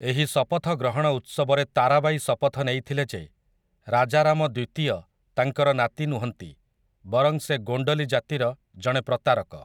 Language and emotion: Odia, neutral